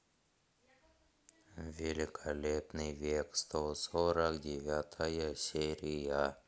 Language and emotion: Russian, neutral